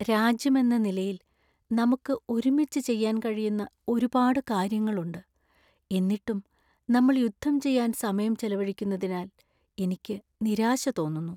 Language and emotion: Malayalam, sad